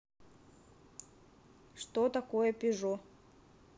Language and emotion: Russian, neutral